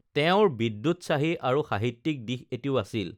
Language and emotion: Assamese, neutral